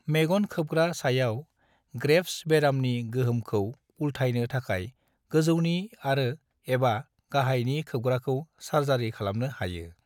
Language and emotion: Bodo, neutral